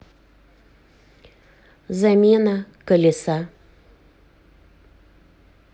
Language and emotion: Russian, neutral